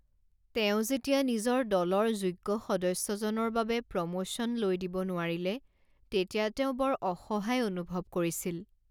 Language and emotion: Assamese, sad